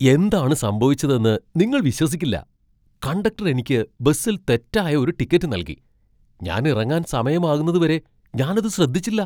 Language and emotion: Malayalam, surprised